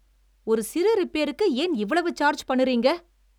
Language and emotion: Tamil, angry